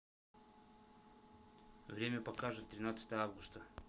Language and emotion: Russian, neutral